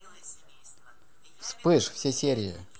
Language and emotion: Russian, positive